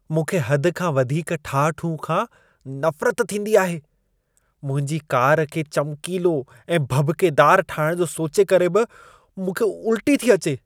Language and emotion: Sindhi, disgusted